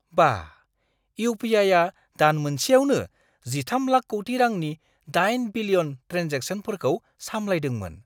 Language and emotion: Bodo, surprised